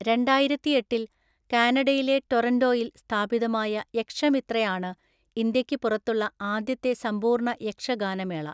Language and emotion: Malayalam, neutral